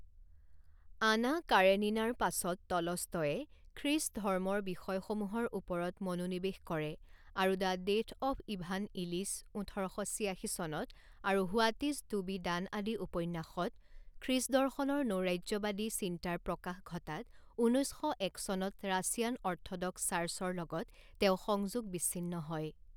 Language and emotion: Assamese, neutral